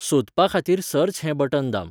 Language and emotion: Goan Konkani, neutral